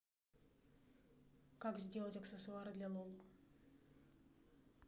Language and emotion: Russian, neutral